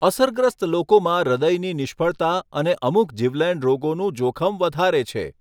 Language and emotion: Gujarati, neutral